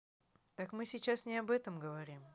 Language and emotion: Russian, angry